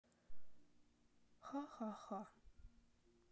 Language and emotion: Russian, neutral